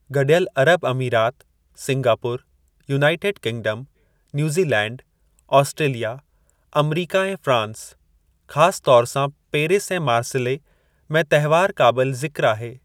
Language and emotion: Sindhi, neutral